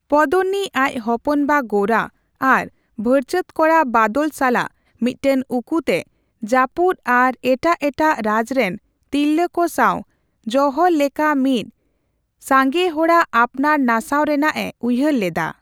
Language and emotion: Santali, neutral